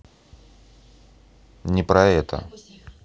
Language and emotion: Russian, neutral